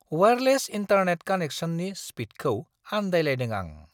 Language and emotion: Bodo, surprised